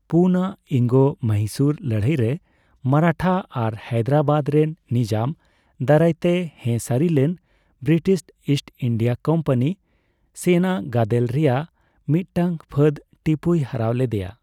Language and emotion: Santali, neutral